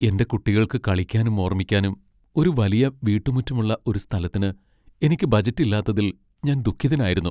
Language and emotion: Malayalam, sad